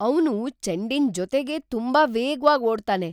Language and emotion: Kannada, surprised